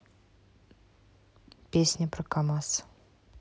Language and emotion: Russian, neutral